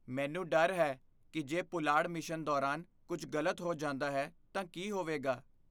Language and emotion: Punjabi, fearful